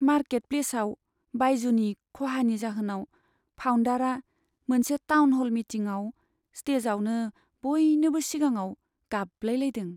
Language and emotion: Bodo, sad